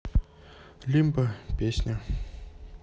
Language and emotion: Russian, neutral